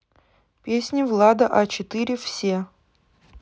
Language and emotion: Russian, neutral